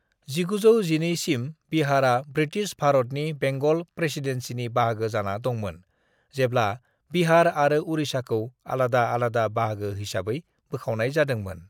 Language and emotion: Bodo, neutral